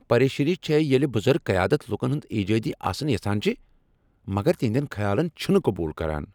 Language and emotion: Kashmiri, angry